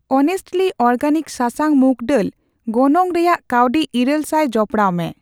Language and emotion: Santali, neutral